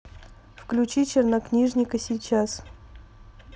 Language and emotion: Russian, neutral